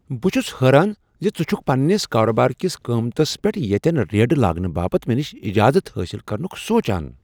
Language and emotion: Kashmiri, surprised